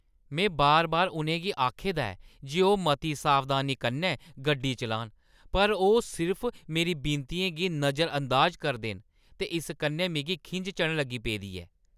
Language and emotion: Dogri, angry